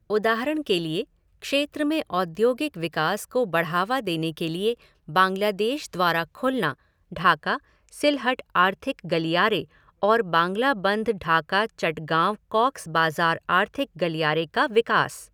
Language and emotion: Hindi, neutral